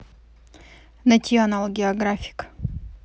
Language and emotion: Russian, neutral